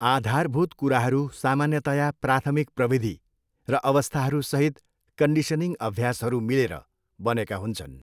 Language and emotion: Nepali, neutral